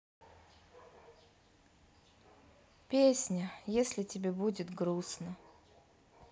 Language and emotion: Russian, sad